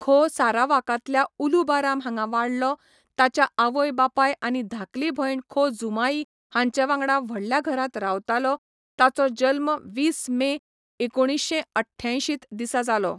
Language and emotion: Goan Konkani, neutral